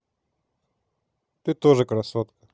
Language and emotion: Russian, neutral